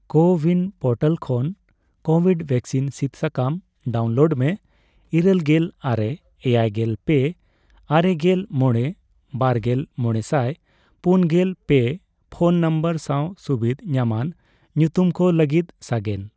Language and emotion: Santali, neutral